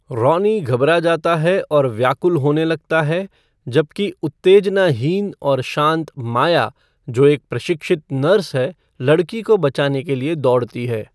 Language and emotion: Hindi, neutral